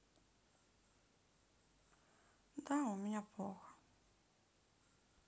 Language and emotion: Russian, sad